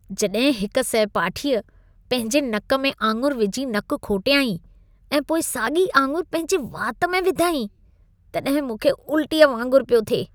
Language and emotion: Sindhi, disgusted